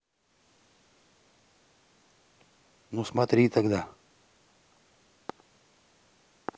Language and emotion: Russian, neutral